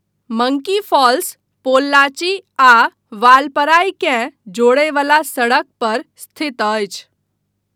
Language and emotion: Maithili, neutral